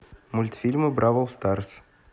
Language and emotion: Russian, neutral